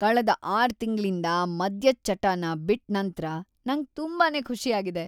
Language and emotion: Kannada, happy